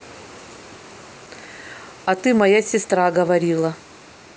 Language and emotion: Russian, neutral